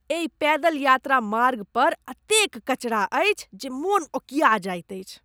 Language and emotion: Maithili, disgusted